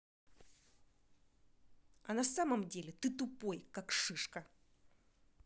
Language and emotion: Russian, angry